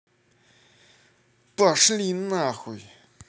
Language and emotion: Russian, angry